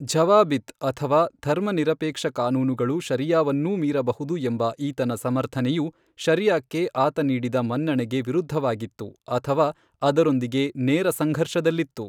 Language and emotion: Kannada, neutral